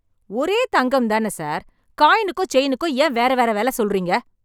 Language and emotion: Tamil, angry